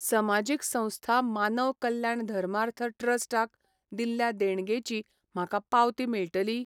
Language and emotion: Goan Konkani, neutral